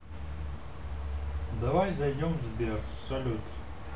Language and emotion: Russian, neutral